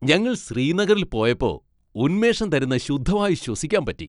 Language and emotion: Malayalam, happy